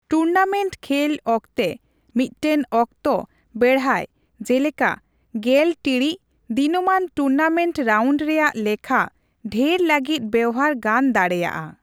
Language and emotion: Santali, neutral